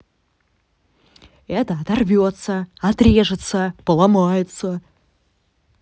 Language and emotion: Russian, angry